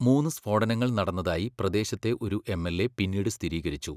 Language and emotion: Malayalam, neutral